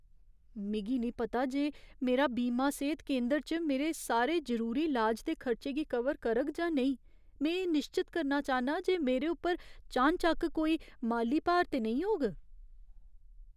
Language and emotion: Dogri, fearful